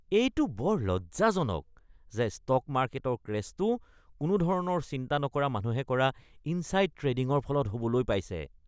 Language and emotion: Assamese, disgusted